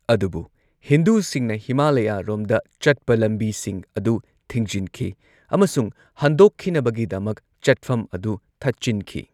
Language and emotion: Manipuri, neutral